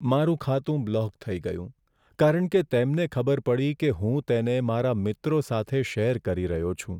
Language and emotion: Gujarati, sad